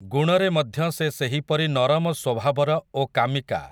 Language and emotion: Odia, neutral